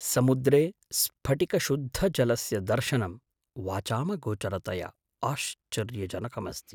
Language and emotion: Sanskrit, surprised